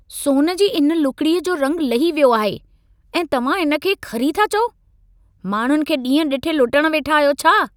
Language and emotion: Sindhi, angry